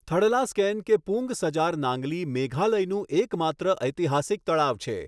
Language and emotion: Gujarati, neutral